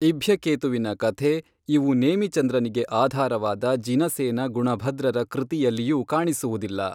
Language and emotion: Kannada, neutral